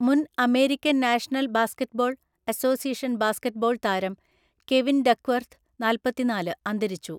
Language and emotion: Malayalam, neutral